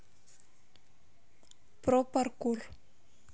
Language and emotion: Russian, neutral